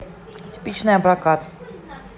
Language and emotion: Russian, neutral